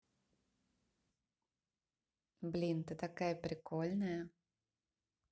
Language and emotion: Russian, positive